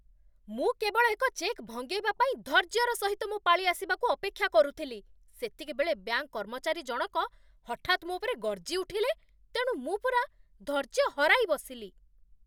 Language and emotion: Odia, angry